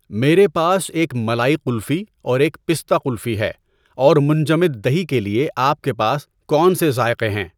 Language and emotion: Urdu, neutral